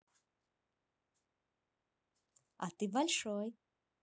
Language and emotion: Russian, positive